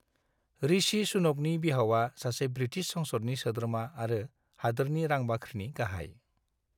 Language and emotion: Bodo, neutral